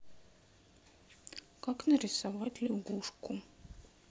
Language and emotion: Russian, sad